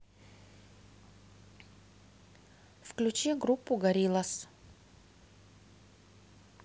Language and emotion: Russian, neutral